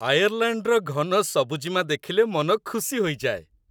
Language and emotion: Odia, happy